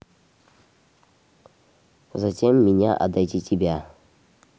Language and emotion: Russian, neutral